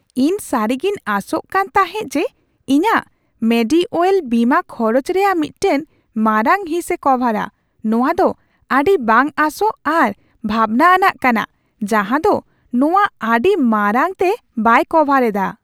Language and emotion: Santali, surprised